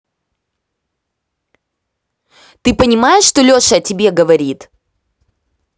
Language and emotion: Russian, angry